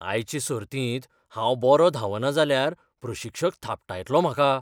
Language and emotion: Goan Konkani, fearful